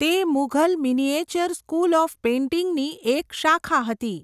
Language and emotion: Gujarati, neutral